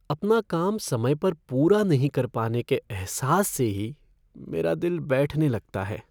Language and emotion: Hindi, sad